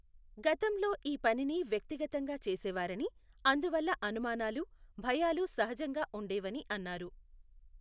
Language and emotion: Telugu, neutral